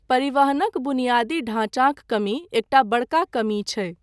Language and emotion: Maithili, neutral